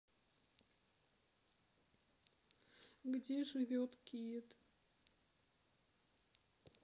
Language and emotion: Russian, sad